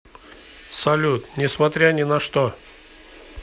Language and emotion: Russian, neutral